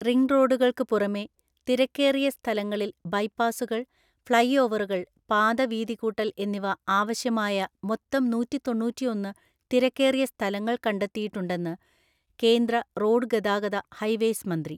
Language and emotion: Malayalam, neutral